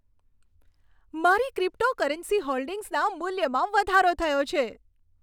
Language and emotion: Gujarati, happy